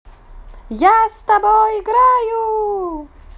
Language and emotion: Russian, positive